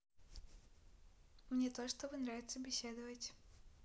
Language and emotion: Russian, positive